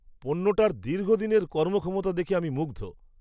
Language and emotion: Bengali, surprised